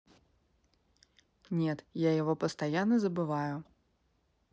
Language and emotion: Russian, neutral